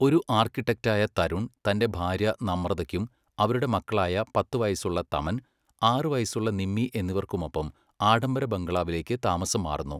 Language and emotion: Malayalam, neutral